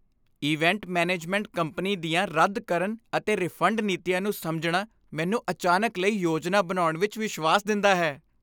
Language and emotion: Punjabi, happy